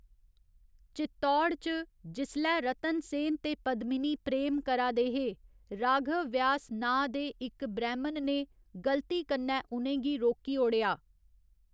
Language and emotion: Dogri, neutral